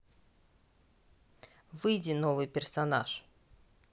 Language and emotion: Russian, neutral